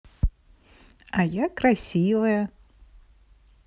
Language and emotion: Russian, positive